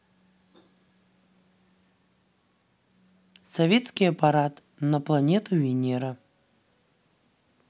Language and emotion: Russian, neutral